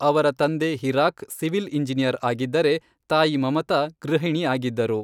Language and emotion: Kannada, neutral